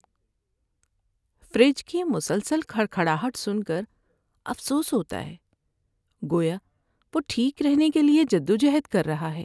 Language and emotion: Urdu, sad